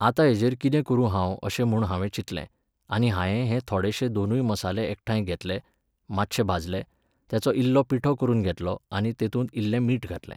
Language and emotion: Goan Konkani, neutral